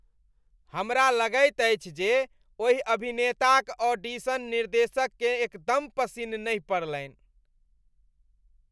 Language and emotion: Maithili, disgusted